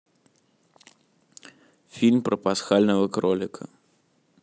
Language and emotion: Russian, neutral